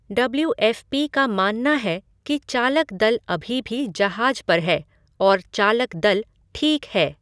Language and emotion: Hindi, neutral